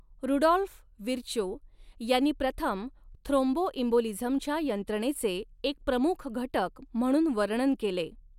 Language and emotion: Marathi, neutral